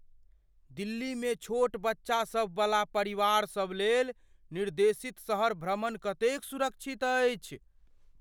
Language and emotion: Maithili, fearful